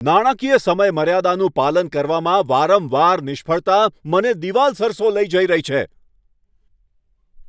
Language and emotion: Gujarati, angry